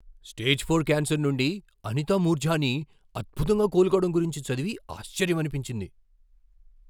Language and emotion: Telugu, surprised